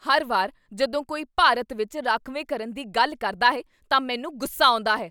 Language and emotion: Punjabi, angry